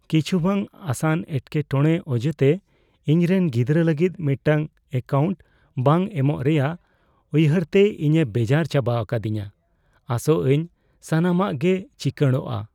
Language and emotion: Santali, fearful